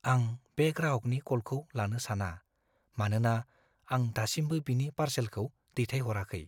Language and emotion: Bodo, fearful